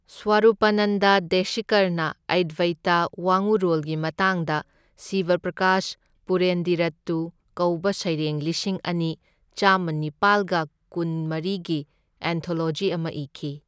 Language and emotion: Manipuri, neutral